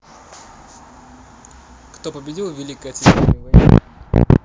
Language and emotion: Russian, neutral